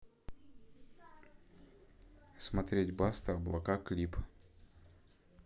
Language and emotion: Russian, neutral